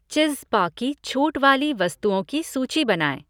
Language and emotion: Hindi, neutral